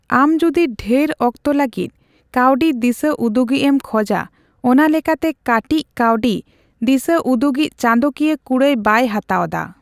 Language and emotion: Santali, neutral